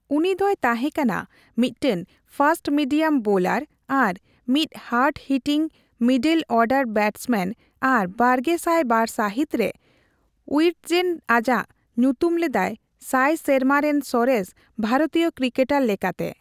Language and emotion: Santali, neutral